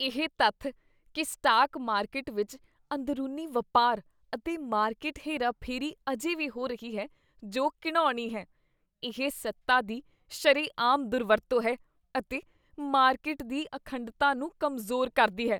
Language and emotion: Punjabi, disgusted